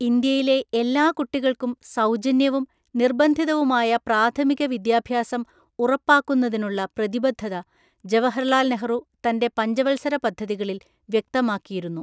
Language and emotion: Malayalam, neutral